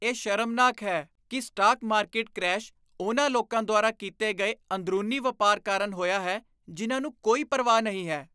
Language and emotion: Punjabi, disgusted